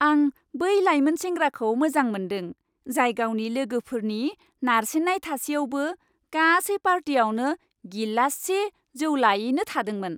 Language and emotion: Bodo, happy